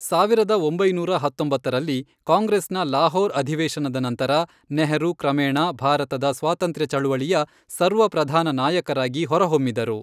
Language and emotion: Kannada, neutral